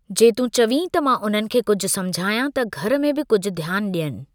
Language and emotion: Sindhi, neutral